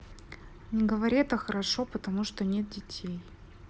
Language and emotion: Russian, neutral